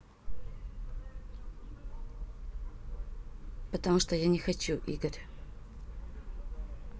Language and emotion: Russian, neutral